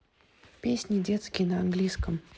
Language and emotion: Russian, neutral